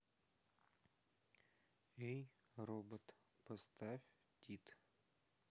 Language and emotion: Russian, neutral